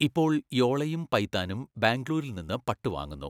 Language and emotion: Malayalam, neutral